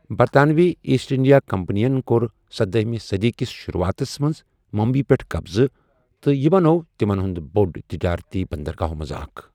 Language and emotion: Kashmiri, neutral